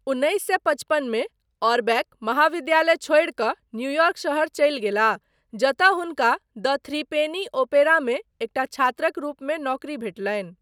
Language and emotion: Maithili, neutral